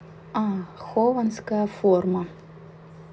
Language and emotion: Russian, neutral